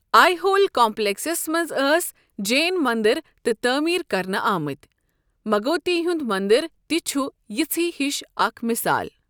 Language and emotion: Kashmiri, neutral